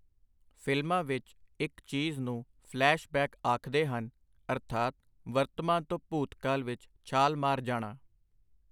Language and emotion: Punjabi, neutral